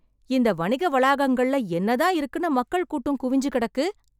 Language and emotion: Tamil, surprised